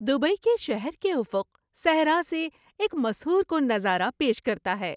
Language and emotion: Urdu, happy